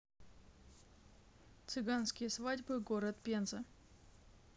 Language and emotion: Russian, neutral